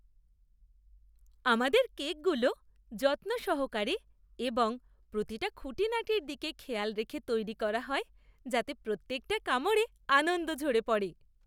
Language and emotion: Bengali, happy